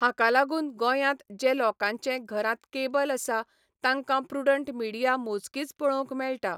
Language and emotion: Goan Konkani, neutral